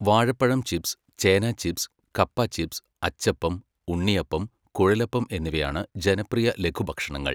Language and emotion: Malayalam, neutral